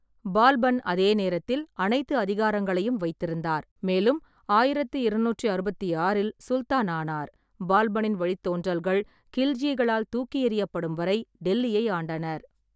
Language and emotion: Tamil, neutral